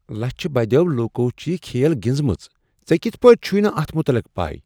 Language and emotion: Kashmiri, surprised